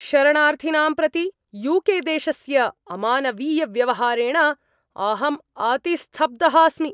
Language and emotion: Sanskrit, angry